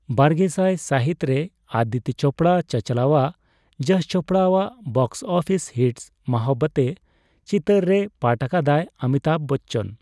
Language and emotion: Santali, neutral